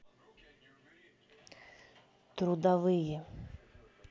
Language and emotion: Russian, neutral